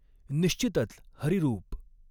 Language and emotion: Marathi, neutral